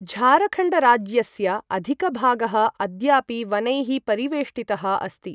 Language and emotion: Sanskrit, neutral